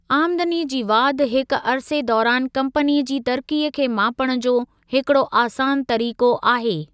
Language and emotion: Sindhi, neutral